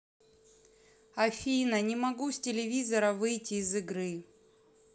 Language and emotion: Russian, neutral